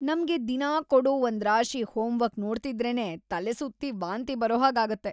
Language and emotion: Kannada, disgusted